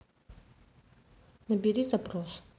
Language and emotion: Russian, neutral